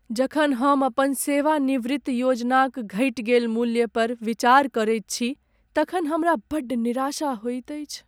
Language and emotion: Maithili, sad